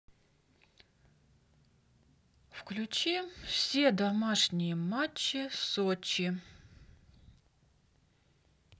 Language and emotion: Russian, neutral